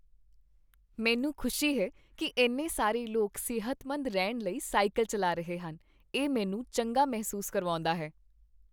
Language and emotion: Punjabi, happy